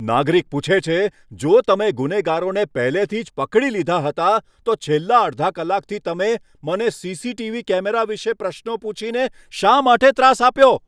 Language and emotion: Gujarati, angry